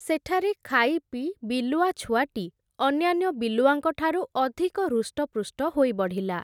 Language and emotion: Odia, neutral